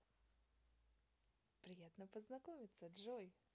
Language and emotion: Russian, positive